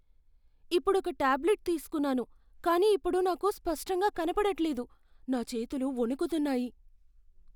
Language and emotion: Telugu, fearful